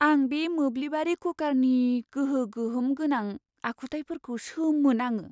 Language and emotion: Bodo, surprised